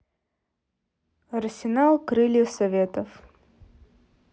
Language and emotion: Russian, neutral